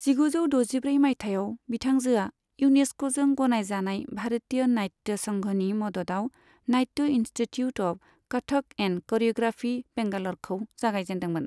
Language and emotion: Bodo, neutral